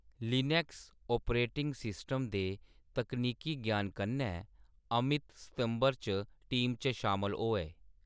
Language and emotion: Dogri, neutral